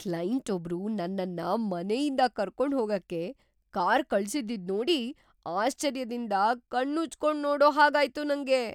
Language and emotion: Kannada, surprised